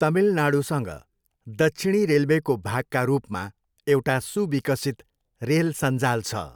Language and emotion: Nepali, neutral